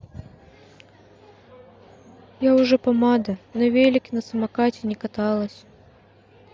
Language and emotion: Russian, sad